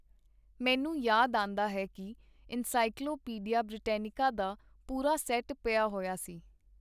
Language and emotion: Punjabi, neutral